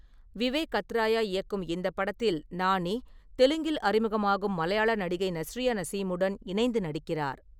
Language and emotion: Tamil, neutral